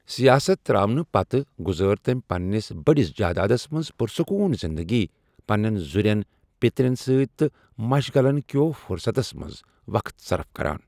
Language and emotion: Kashmiri, neutral